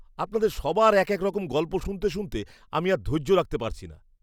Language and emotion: Bengali, disgusted